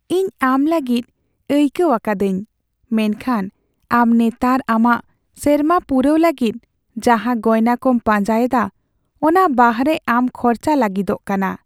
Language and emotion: Santali, sad